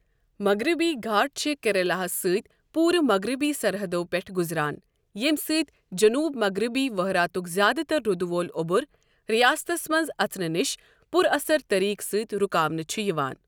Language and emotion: Kashmiri, neutral